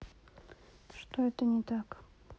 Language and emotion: Russian, sad